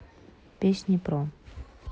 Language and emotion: Russian, neutral